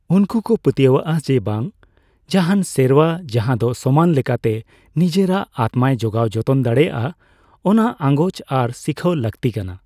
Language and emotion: Santali, neutral